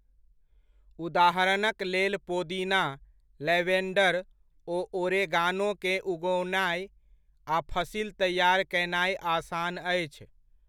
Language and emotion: Maithili, neutral